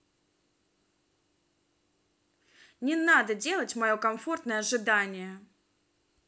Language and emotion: Russian, angry